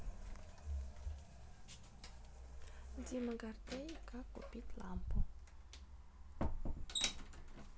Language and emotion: Russian, neutral